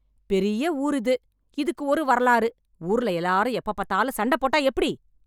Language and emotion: Tamil, angry